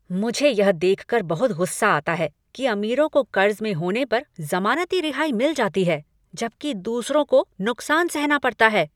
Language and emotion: Hindi, angry